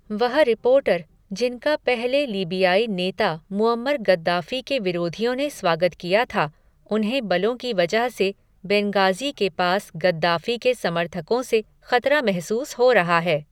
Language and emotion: Hindi, neutral